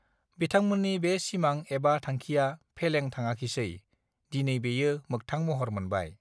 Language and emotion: Bodo, neutral